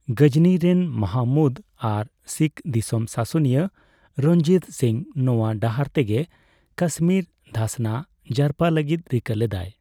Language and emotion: Santali, neutral